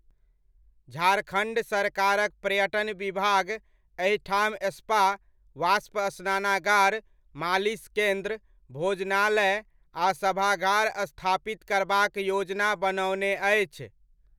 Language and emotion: Maithili, neutral